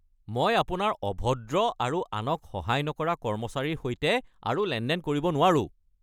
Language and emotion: Assamese, angry